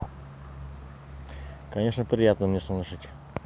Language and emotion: Russian, neutral